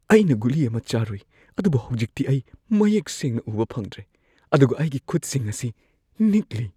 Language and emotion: Manipuri, fearful